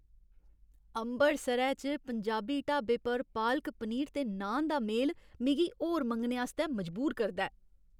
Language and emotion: Dogri, happy